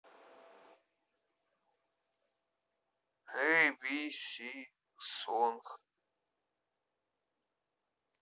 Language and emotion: Russian, neutral